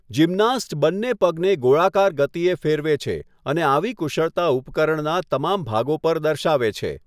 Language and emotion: Gujarati, neutral